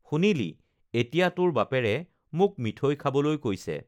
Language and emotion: Assamese, neutral